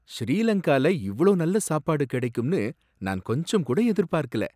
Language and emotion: Tamil, surprised